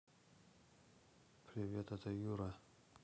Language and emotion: Russian, neutral